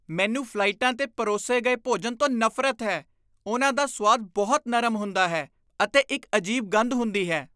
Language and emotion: Punjabi, disgusted